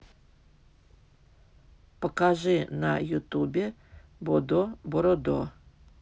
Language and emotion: Russian, neutral